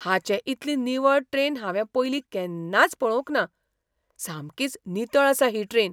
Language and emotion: Goan Konkani, surprised